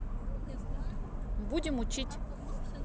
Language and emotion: Russian, neutral